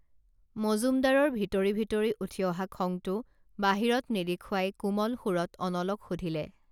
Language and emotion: Assamese, neutral